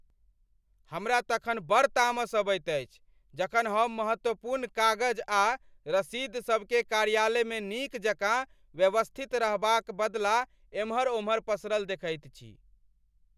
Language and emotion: Maithili, angry